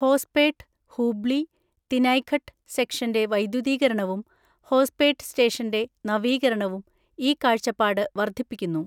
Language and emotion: Malayalam, neutral